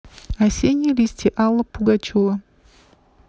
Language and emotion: Russian, neutral